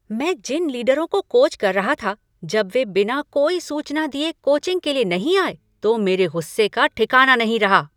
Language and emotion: Hindi, angry